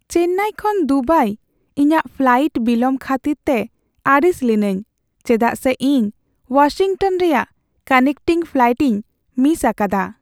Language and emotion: Santali, sad